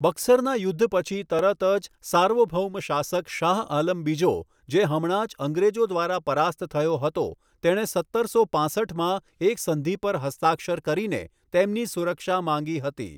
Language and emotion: Gujarati, neutral